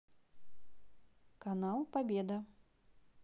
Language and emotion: Russian, neutral